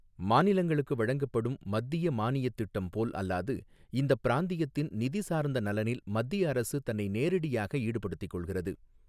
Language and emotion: Tamil, neutral